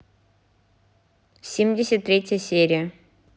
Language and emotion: Russian, neutral